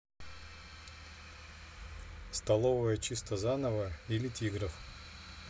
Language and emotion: Russian, neutral